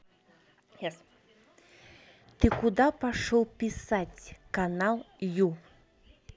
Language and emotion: Russian, angry